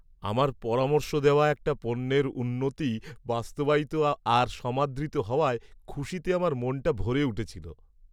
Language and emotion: Bengali, happy